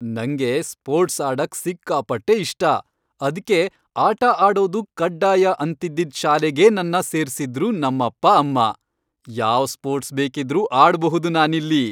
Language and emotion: Kannada, happy